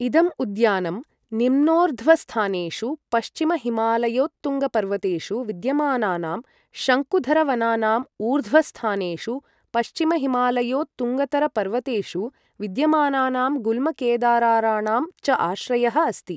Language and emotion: Sanskrit, neutral